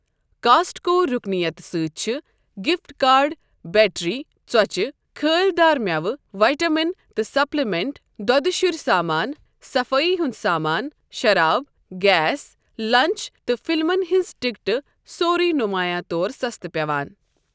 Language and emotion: Kashmiri, neutral